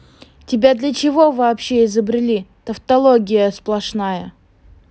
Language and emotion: Russian, angry